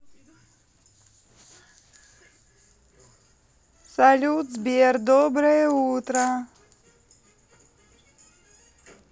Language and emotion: Russian, positive